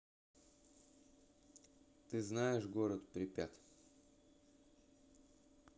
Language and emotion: Russian, neutral